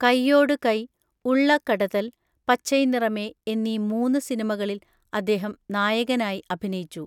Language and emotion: Malayalam, neutral